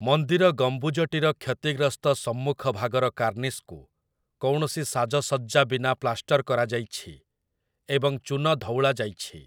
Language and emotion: Odia, neutral